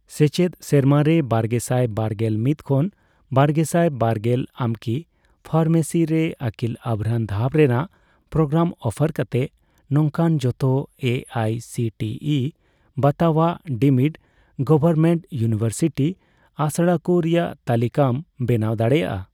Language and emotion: Santali, neutral